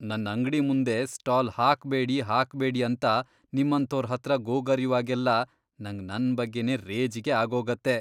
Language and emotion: Kannada, disgusted